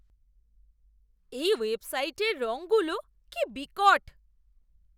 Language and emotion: Bengali, disgusted